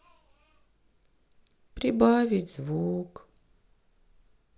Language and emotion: Russian, sad